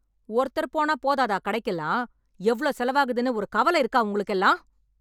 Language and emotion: Tamil, angry